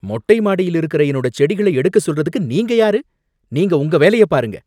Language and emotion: Tamil, angry